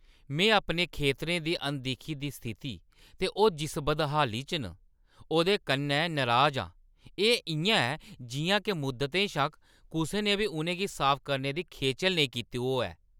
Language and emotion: Dogri, angry